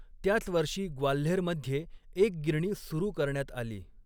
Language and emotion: Marathi, neutral